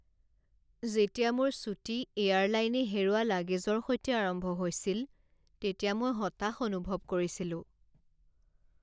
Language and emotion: Assamese, sad